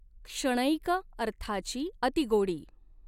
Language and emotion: Marathi, neutral